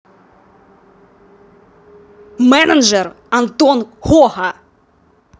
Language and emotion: Russian, angry